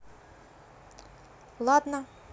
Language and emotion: Russian, neutral